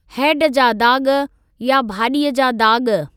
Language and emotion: Sindhi, neutral